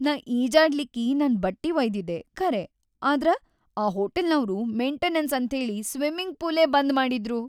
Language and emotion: Kannada, sad